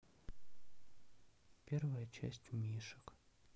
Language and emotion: Russian, sad